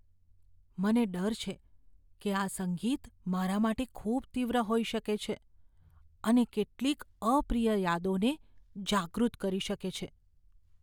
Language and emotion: Gujarati, fearful